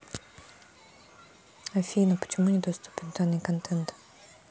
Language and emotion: Russian, neutral